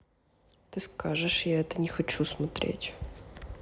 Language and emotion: Russian, neutral